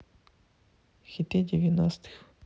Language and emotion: Russian, neutral